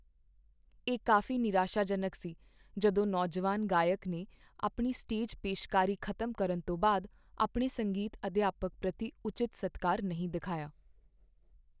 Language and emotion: Punjabi, sad